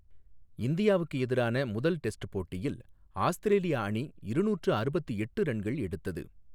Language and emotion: Tamil, neutral